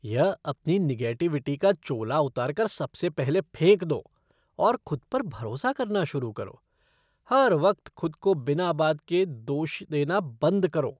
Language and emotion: Hindi, disgusted